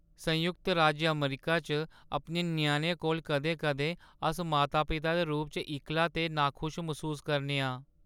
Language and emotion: Dogri, sad